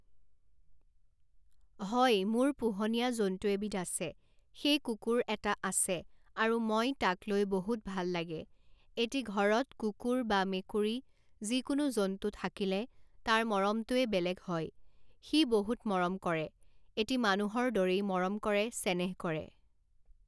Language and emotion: Assamese, neutral